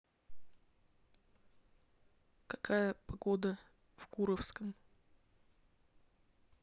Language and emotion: Russian, neutral